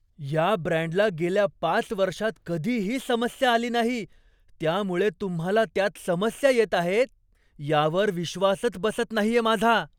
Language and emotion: Marathi, surprised